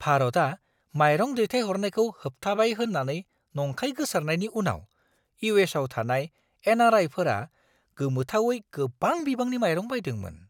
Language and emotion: Bodo, surprised